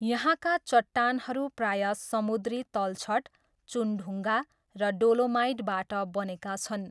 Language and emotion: Nepali, neutral